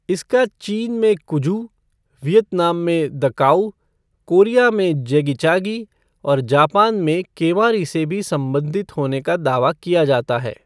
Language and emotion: Hindi, neutral